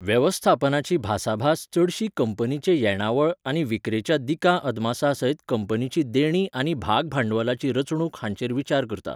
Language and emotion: Goan Konkani, neutral